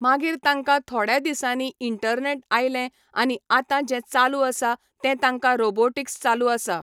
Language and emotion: Goan Konkani, neutral